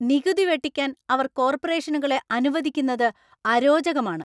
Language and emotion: Malayalam, angry